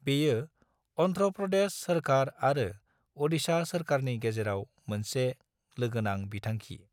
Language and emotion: Bodo, neutral